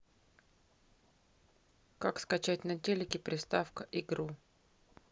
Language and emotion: Russian, neutral